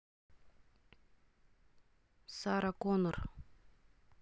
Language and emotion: Russian, neutral